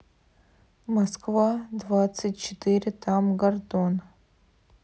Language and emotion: Russian, neutral